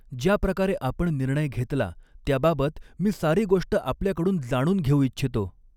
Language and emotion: Marathi, neutral